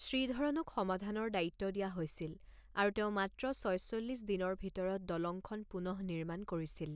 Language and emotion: Assamese, neutral